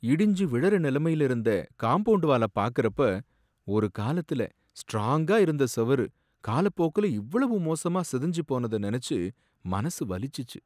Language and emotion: Tamil, sad